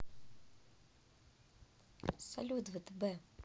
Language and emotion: Russian, neutral